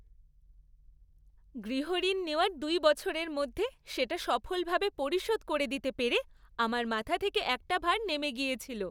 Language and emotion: Bengali, happy